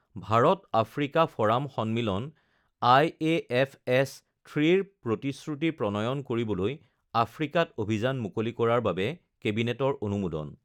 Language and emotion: Assamese, neutral